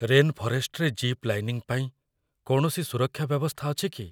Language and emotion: Odia, fearful